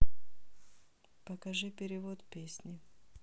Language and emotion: Russian, neutral